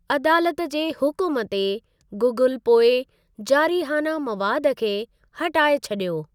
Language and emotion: Sindhi, neutral